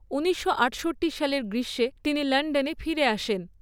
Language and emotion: Bengali, neutral